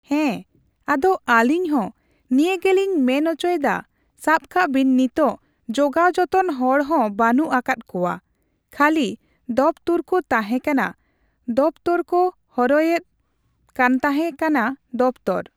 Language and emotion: Santali, neutral